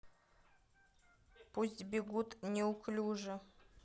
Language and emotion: Russian, neutral